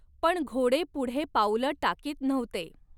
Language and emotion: Marathi, neutral